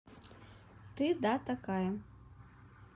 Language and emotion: Russian, neutral